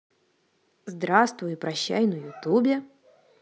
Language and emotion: Russian, positive